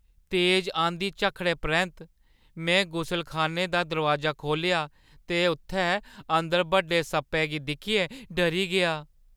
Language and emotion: Dogri, fearful